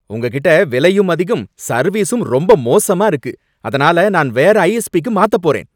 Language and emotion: Tamil, angry